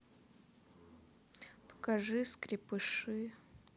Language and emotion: Russian, neutral